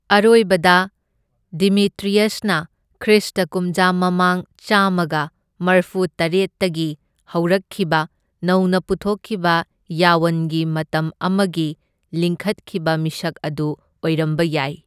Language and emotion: Manipuri, neutral